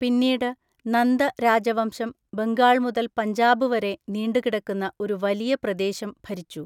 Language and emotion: Malayalam, neutral